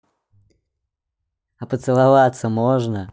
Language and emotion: Russian, positive